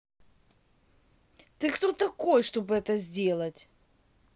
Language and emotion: Russian, angry